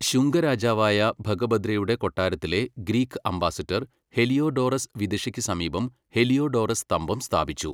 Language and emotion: Malayalam, neutral